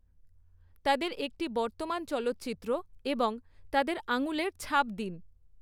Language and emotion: Bengali, neutral